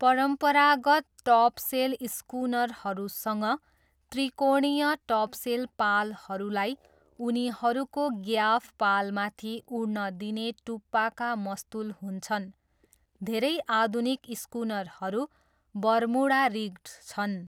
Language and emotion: Nepali, neutral